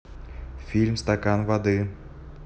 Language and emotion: Russian, neutral